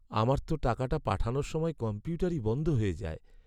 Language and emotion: Bengali, sad